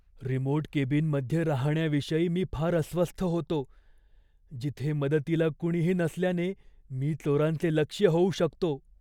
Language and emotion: Marathi, fearful